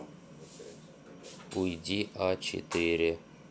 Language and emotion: Russian, neutral